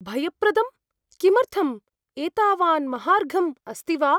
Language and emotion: Sanskrit, fearful